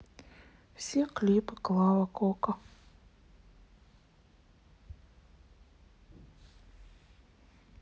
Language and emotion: Russian, sad